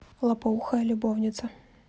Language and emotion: Russian, neutral